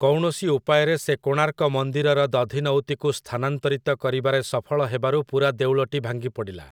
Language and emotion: Odia, neutral